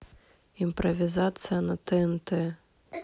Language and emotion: Russian, neutral